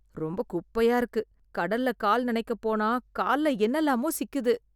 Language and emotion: Tamil, disgusted